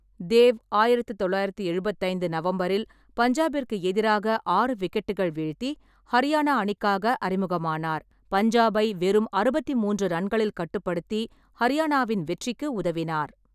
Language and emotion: Tamil, neutral